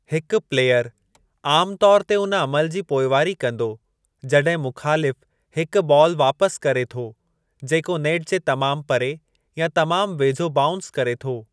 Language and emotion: Sindhi, neutral